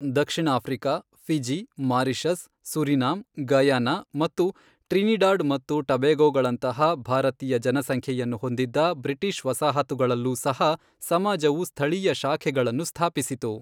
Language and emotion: Kannada, neutral